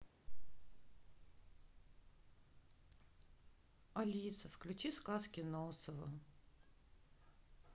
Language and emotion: Russian, sad